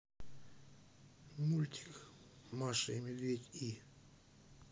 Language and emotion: Russian, neutral